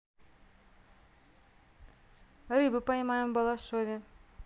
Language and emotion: Russian, neutral